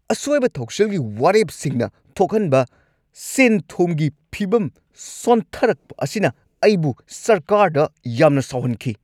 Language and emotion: Manipuri, angry